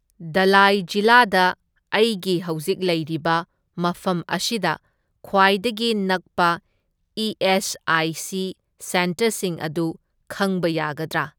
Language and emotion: Manipuri, neutral